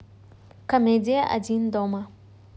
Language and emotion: Russian, neutral